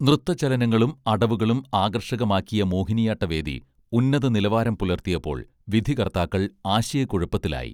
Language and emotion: Malayalam, neutral